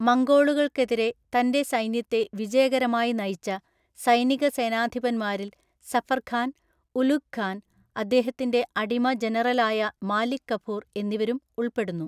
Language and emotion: Malayalam, neutral